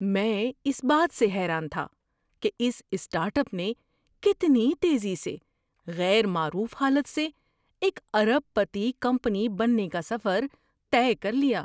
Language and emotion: Urdu, surprised